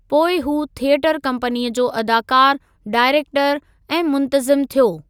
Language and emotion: Sindhi, neutral